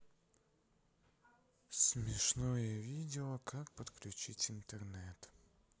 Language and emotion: Russian, sad